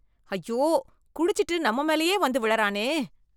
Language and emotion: Tamil, disgusted